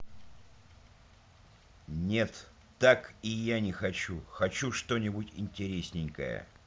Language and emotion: Russian, neutral